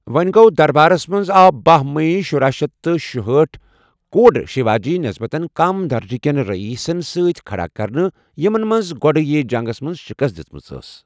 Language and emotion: Kashmiri, neutral